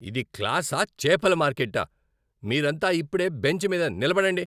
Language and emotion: Telugu, angry